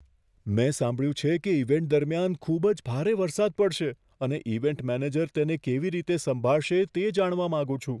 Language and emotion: Gujarati, fearful